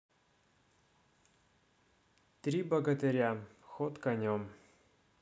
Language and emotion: Russian, neutral